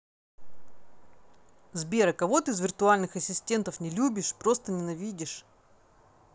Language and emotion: Russian, angry